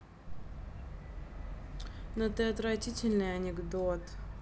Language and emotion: Russian, angry